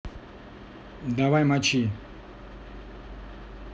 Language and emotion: Russian, neutral